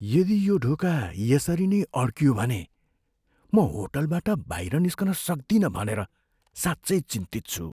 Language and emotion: Nepali, fearful